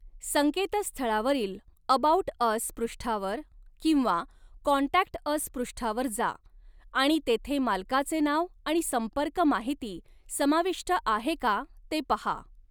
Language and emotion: Marathi, neutral